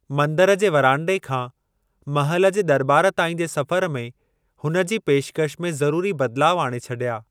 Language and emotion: Sindhi, neutral